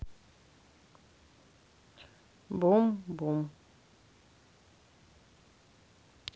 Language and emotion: Russian, neutral